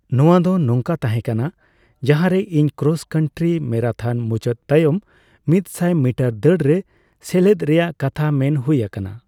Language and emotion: Santali, neutral